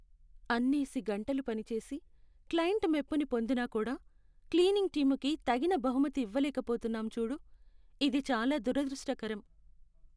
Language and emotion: Telugu, sad